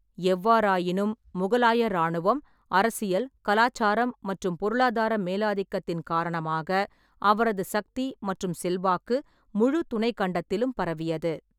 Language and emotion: Tamil, neutral